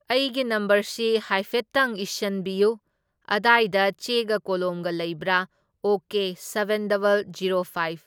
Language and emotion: Manipuri, neutral